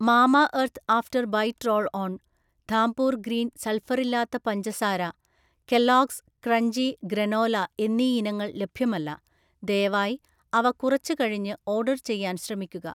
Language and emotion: Malayalam, neutral